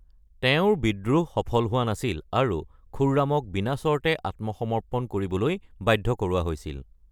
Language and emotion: Assamese, neutral